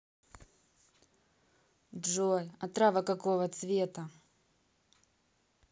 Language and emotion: Russian, neutral